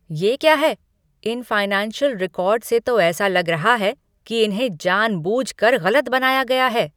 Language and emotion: Hindi, angry